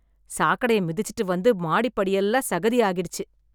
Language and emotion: Tamil, disgusted